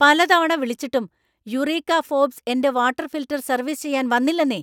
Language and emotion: Malayalam, angry